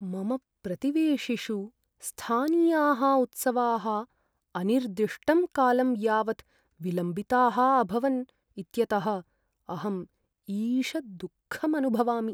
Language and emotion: Sanskrit, sad